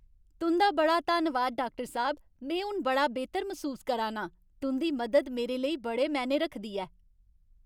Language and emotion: Dogri, happy